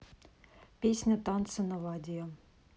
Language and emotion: Russian, neutral